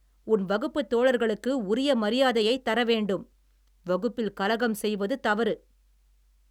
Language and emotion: Tamil, angry